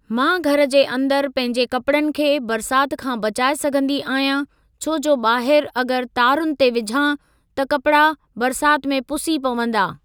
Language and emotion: Sindhi, neutral